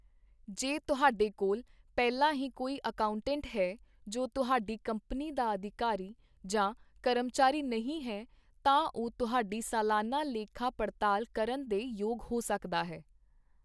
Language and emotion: Punjabi, neutral